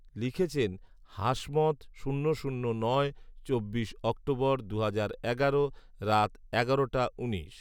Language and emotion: Bengali, neutral